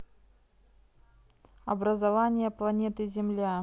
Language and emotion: Russian, neutral